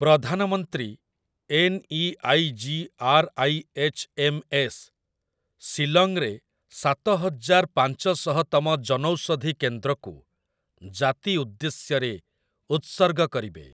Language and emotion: Odia, neutral